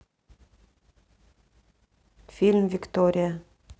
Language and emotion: Russian, neutral